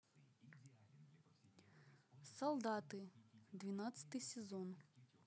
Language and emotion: Russian, neutral